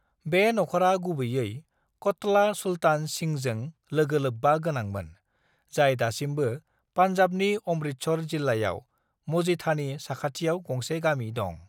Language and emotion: Bodo, neutral